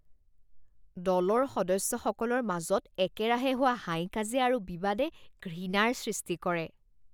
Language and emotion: Assamese, disgusted